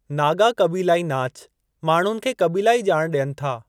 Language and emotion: Sindhi, neutral